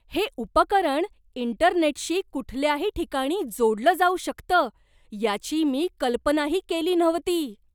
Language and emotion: Marathi, surprised